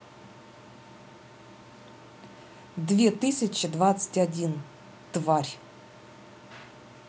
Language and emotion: Russian, angry